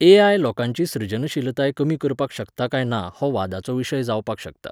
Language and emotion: Goan Konkani, neutral